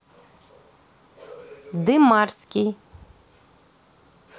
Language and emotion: Russian, neutral